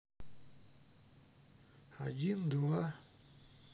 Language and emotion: Russian, neutral